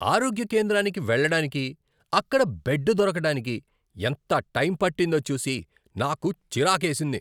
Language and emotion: Telugu, angry